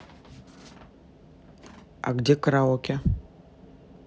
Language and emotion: Russian, neutral